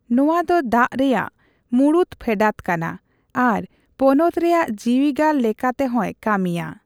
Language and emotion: Santali, neutral